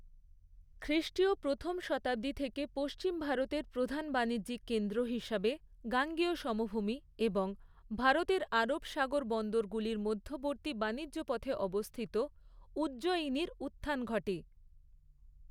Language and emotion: Bengali, neutral